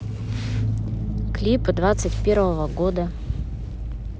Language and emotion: Russian, neutral